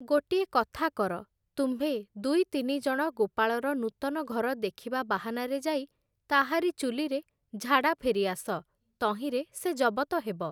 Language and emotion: Odia, neutral